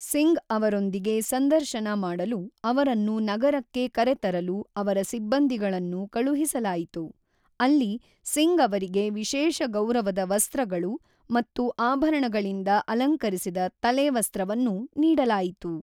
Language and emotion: Kannada, neutral